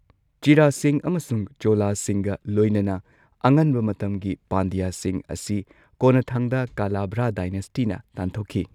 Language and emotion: Manipuri, neutral